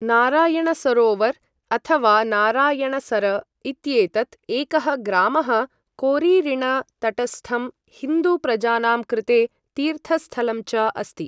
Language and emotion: Sanskrit, neutral